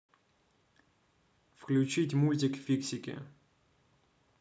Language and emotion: Russian, neutral